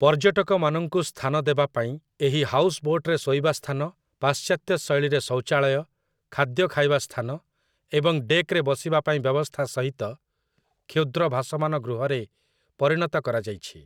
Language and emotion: Odia, neutral